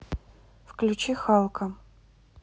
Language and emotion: Russian, neutral